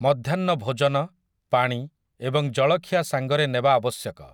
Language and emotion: Odia, neutral